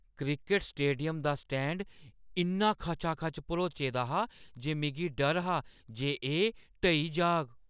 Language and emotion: Dogri, fearful